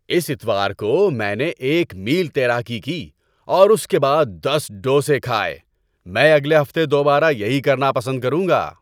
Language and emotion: Urdu, happy